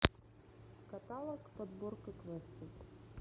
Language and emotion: Russian, neutral